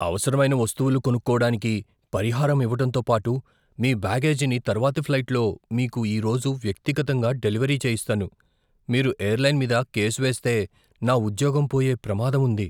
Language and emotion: Telugu, fearful